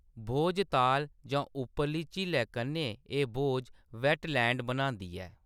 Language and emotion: Dogri, neutral